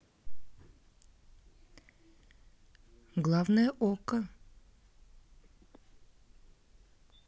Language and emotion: Russian, neutral